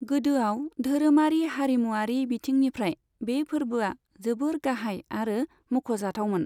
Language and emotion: Bodo, neutral